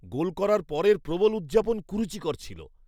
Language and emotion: Bengali, disgusted